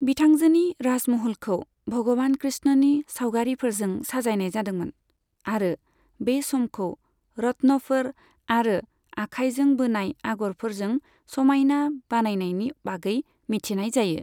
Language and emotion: Bodo, neutral